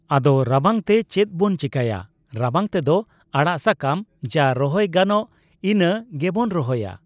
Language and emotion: Santali, neutral